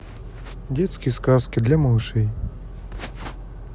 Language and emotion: Russian, neutral